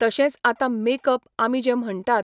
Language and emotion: Goan Konkani, neutral